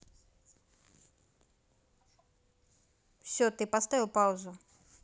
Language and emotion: Russian, neutral